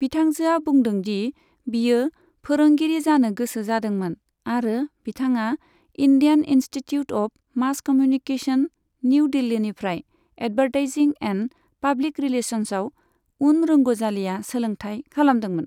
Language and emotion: Bodo, neutral